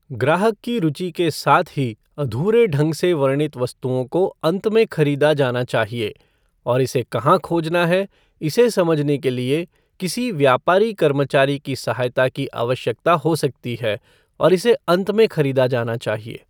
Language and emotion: Hindi, neutral